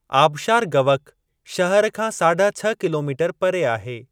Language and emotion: Sindhi, neutral